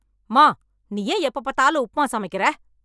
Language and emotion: Tamil, angry